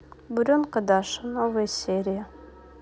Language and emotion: Russian, neutral